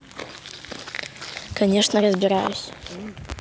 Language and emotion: Russian, neutral